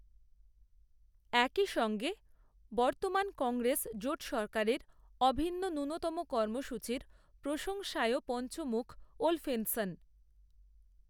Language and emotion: Bengali, neutral